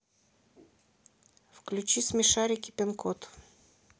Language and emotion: Russian, neutral